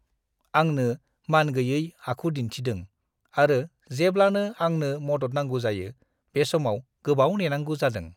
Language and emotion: Bodo, disgusted